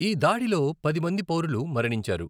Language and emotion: Telugu, neutral